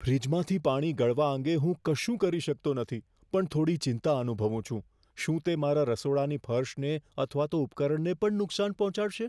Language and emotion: Gujarati, fearful